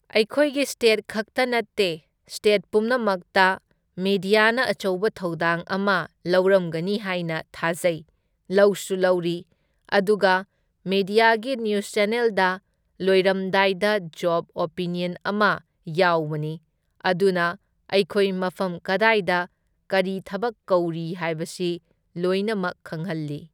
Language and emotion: Manipuri, neutral